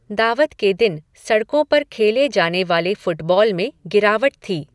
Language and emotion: Hindi, neutral